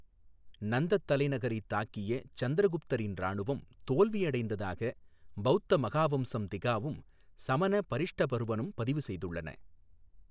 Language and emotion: Tamil, neutral